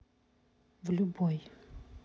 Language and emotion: Russian, neutral